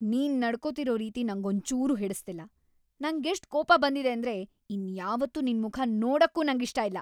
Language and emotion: Kannada, angry